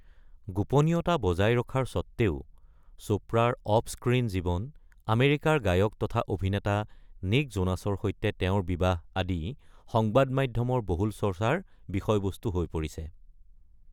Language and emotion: Assamese, neutral